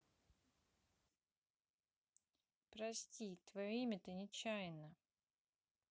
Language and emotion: Russian, sad